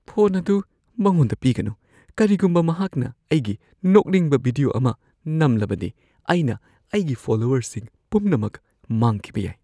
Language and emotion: Manipuri, fearful